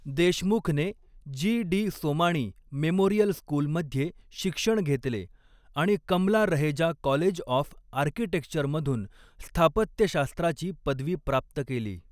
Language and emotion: Marathi, neutral